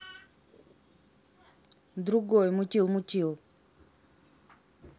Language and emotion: Russian, neutral